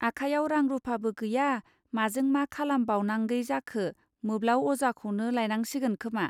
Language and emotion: Bodo, neutral